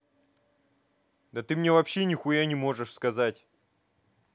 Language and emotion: Russian, angry